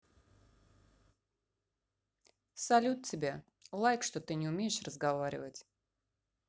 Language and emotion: Russian, neutral